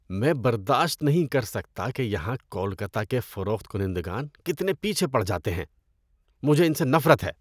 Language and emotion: Urdu, disgusted